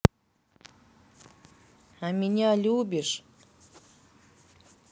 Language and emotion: Russian, neutral